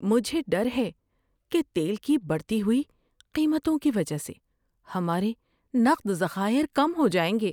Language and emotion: Urdu, fearful